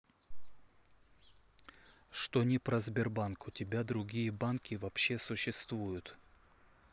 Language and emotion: Russian, neutral